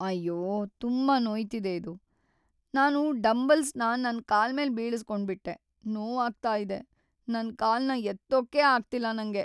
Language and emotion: Kannada, sad